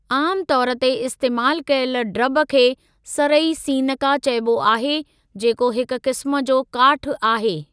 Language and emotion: Sindhi, neutral